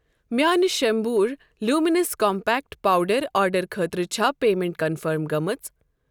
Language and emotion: Kashmiri, neutral